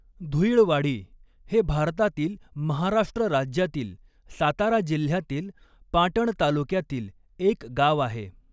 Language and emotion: Marathi, neutral